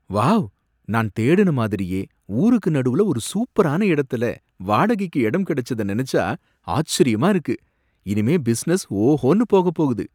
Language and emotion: Tamil, surprised